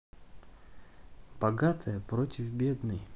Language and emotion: Russian, neutral